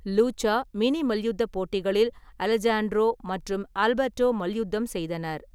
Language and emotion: Tamil, neutral